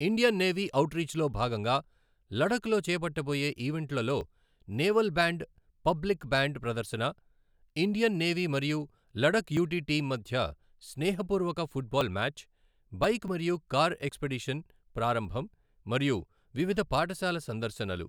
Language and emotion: Telugu, neutral